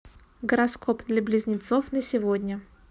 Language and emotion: Russian, neutral